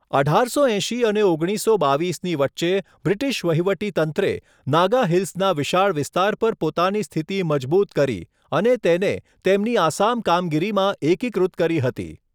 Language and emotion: Gujarati, neutral